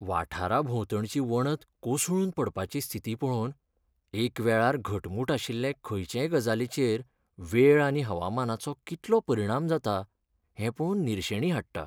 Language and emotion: Goan Konkani, sad